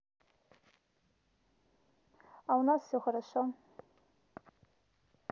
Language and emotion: Russian, neutral